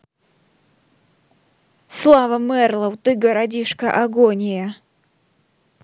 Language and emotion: Russian, neutral